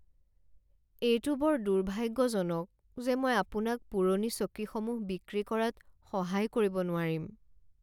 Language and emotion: Assamese, sad